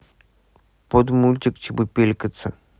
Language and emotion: Russian, neutral